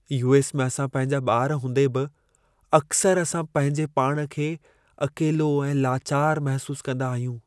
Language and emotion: Sindhi, sad